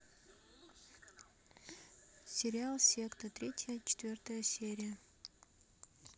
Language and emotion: Russian, neutral